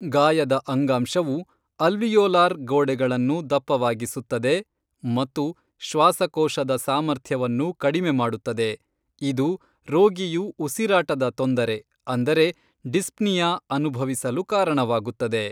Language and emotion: Kannada, neutral